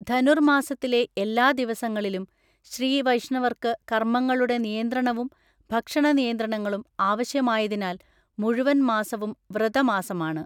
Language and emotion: Malayalam, neutral